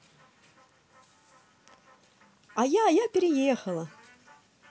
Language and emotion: Russian, positive